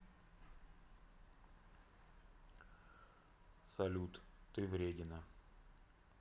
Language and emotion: Russian, neutral